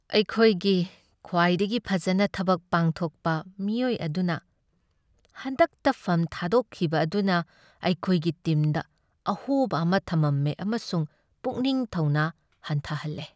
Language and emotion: Manipuri, sad